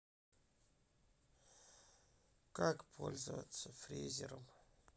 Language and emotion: Russian, sad